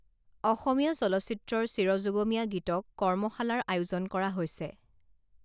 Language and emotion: Assamese, neutral